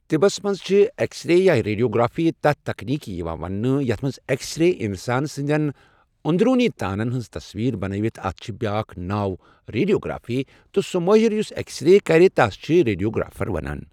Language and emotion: Kashmiri, neutral